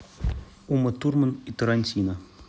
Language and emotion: Russian, neutral